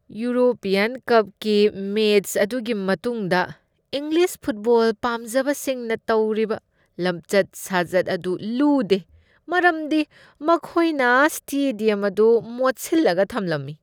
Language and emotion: Manipuri, disgusted